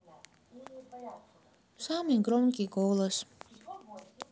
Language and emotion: Russian, sad